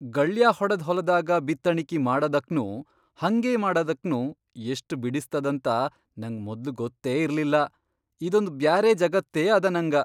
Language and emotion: Kannada, surprised